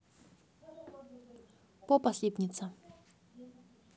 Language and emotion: Russian, neutral